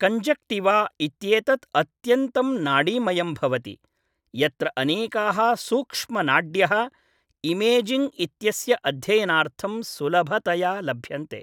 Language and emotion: Sanskrit, neutral